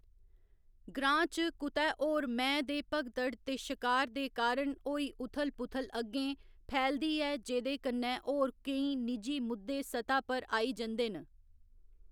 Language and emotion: Dogri, neutral